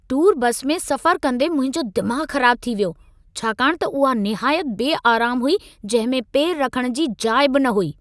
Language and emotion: Sindhi, angry